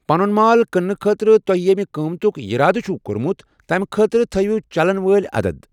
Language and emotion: Kashmiri, neutral